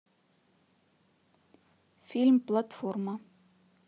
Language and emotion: Russian, neutral